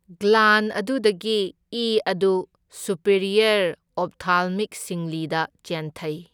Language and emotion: Manipuri, neutral